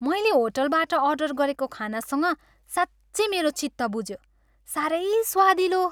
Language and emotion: Nepali, happy